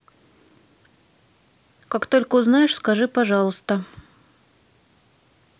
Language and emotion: Russian, neutral